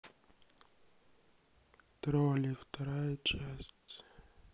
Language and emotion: Russian, sad